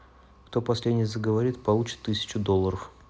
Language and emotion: Russian, neutral